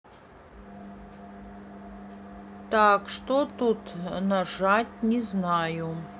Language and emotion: Russian, neutral